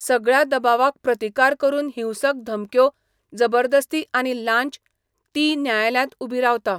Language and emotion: Goan Konkani, neutral